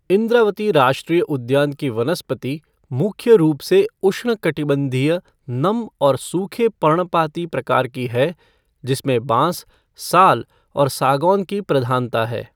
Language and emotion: Hindi, neutral